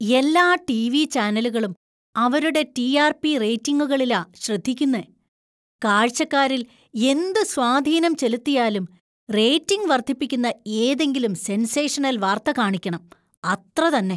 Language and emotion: Malayalam, disgusted